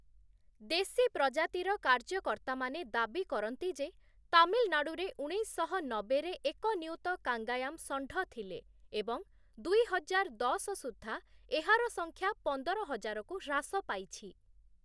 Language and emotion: Odia, neutral